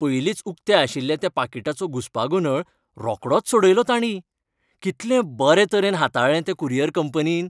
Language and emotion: Goan Konkani, happy